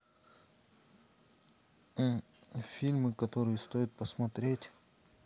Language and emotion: Russian, neutral